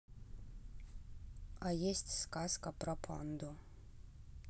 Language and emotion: Russian, neutral